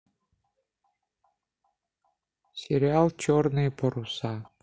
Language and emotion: Russian, neutral